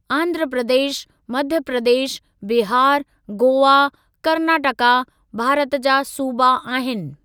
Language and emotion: Sindhi, neutral